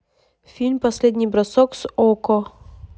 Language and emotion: Russian, neutral